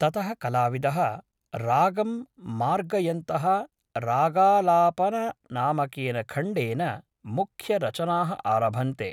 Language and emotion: Sanskrit, neutral